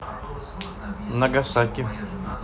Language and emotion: Russian, neutral